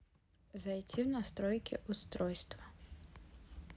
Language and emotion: Russian, neutral